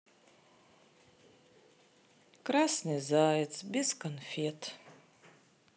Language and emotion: Russian, sad